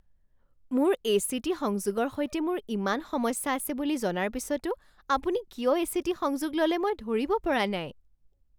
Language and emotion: Assamese, surprised